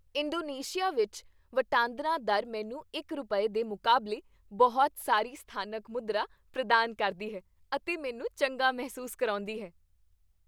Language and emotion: Punjabi, happy